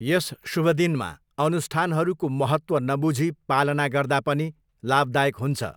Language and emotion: Nepali, neutral